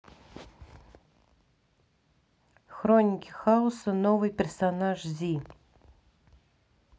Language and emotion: Russian, neutral